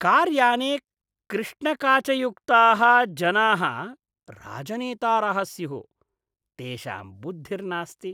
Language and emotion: Sanskrit, disgusted